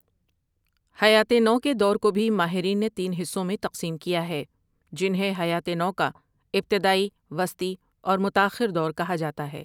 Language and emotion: Urdu, neutral